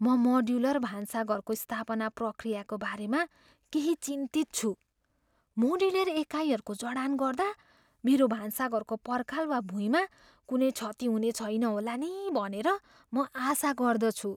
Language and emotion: Nepali, fearful